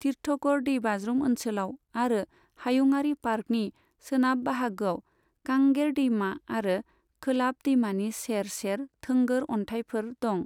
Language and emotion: Bodo, neutral